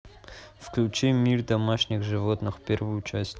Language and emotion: Russian, neutral